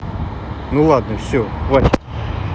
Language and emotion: Russian, neutral